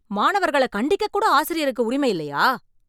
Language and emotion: Tamil, angry